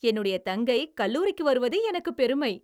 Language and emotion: Tamil, happy